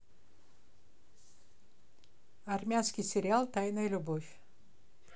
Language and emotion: Russian, neutral